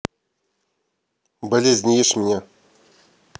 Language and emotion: Russian, neutral